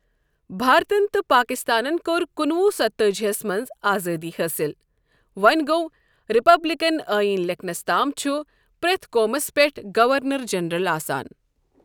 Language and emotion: Kashmiri, neutral